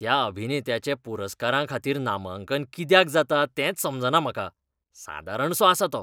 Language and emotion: Goan Konkani, disgusted